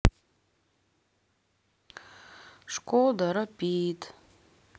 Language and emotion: Russian, neutral